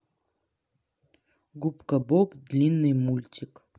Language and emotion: Russian, neutral